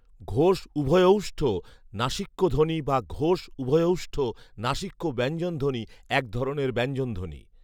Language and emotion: Bengali, neutral